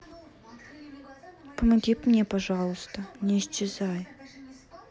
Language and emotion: Russian, sad